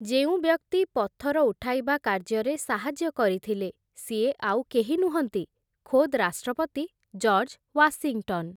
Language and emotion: Odia, neutral